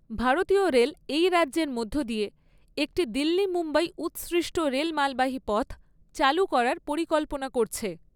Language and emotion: Bengali, neutral